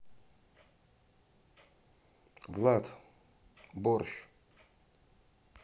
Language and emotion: Russian, neutral